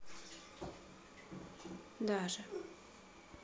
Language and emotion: Russian, neutral